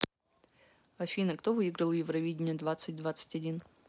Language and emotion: Russian, neutral